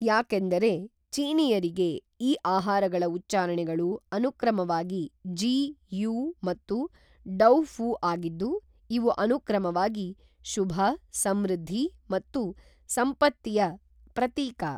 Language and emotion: Kannada, neutral